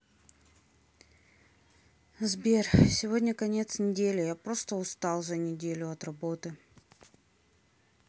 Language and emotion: Russian, sad